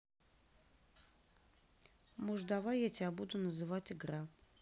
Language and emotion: Russian, neutral